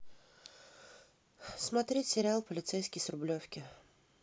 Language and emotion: Russian, sad